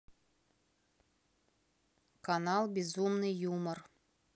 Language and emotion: Russian, neutral